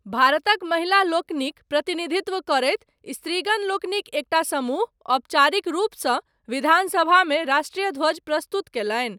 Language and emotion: Maithili, neutral